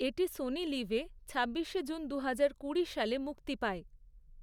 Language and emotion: Bengali, neutral